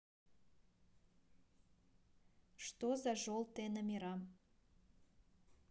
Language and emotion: Russian, neutral